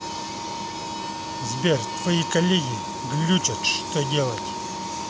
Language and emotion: Russian, angry